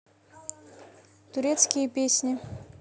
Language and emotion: Russian, neutral